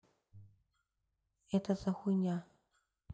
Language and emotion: Russian, neutral